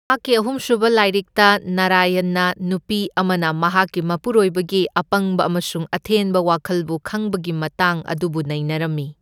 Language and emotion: Manipuri, neutral